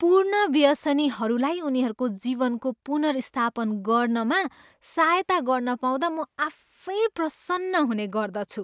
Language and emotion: Nepali, happy